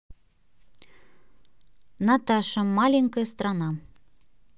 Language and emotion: Russian, neutral